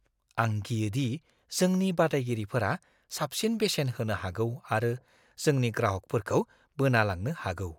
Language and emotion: Bodo, fearful